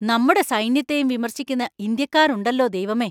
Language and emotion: Malayalam, angry